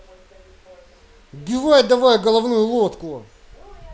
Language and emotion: Russian, angry